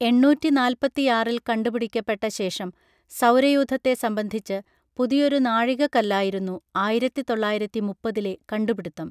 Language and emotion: Malayalam, neutral